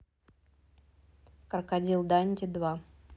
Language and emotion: Russian, neutral